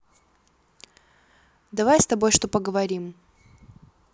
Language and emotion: Russian, neutral